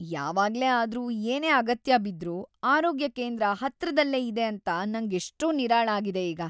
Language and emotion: Kannada, happy